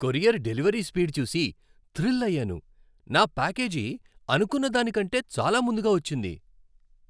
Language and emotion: Telugu, happy